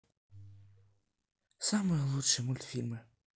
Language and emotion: Russian, sad